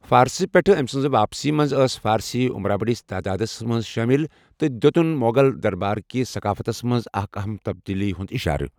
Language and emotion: Kashmiri, neutral